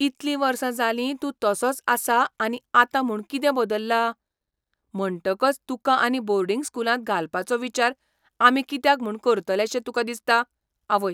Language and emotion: Goan Konkani, surprised